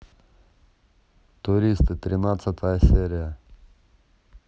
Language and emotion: Russian, neutral